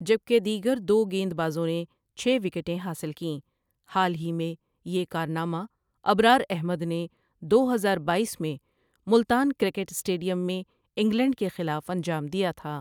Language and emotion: Urdu, neutral